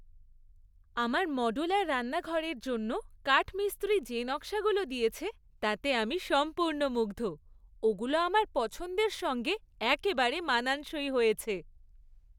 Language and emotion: Bengali, happy